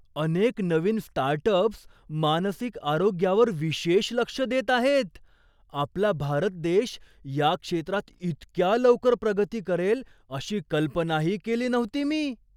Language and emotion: Marathi, surprised